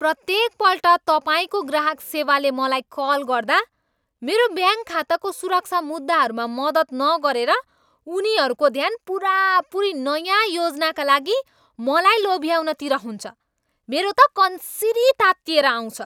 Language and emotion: Nepali, angry